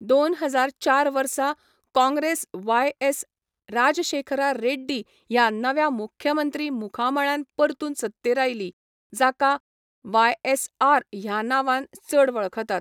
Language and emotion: Goan Konkani, neutral